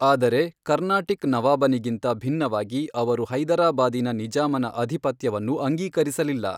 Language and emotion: Kannada, neutral